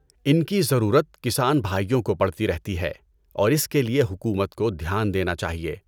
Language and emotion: Urdu, neutral